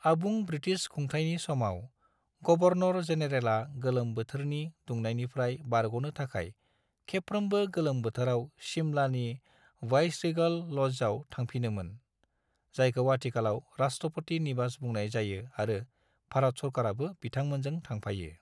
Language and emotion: Bodo, neutral